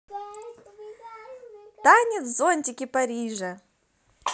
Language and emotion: Russian, positive